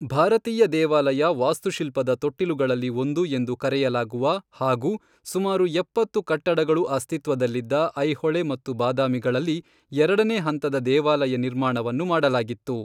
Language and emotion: Kannada, neutral